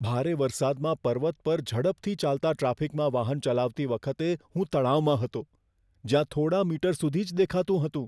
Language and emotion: Gujarati, fearful